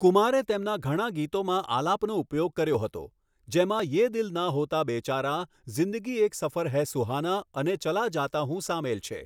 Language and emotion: Gujarati, neutral